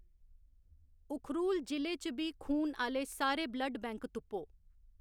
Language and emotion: Dogri, neutral